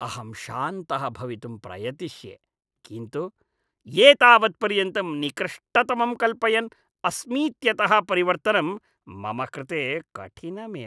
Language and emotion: Sanskrit, disgusted